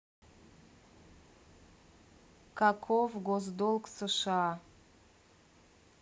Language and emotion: Russian, neutral